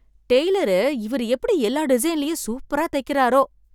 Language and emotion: Tamil, surprised